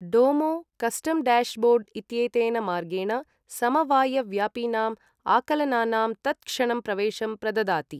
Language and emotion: Sanskrit, neutral